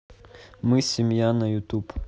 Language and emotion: Russian, neutral